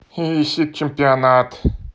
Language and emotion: Russian, neutral